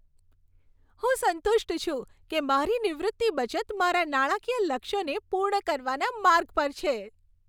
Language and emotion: Gujarati, happy